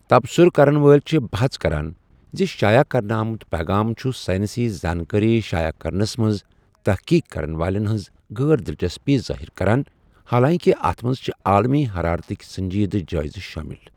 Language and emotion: Kashmiri, neutral